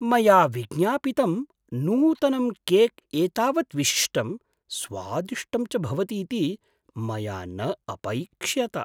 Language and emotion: Sanskrit, surprised